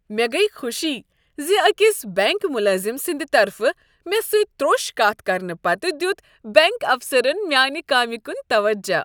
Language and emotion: Kashmiri, happy